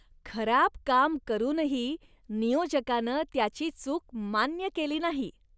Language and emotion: Marathi, disgusted